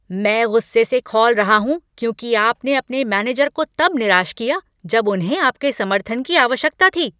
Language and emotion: Hindi, angry